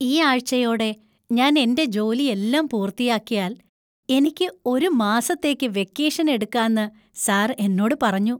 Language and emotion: Malayalam, happy